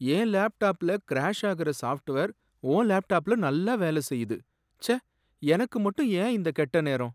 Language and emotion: Tamil, sad